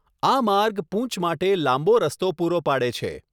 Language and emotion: Gujarati, neutral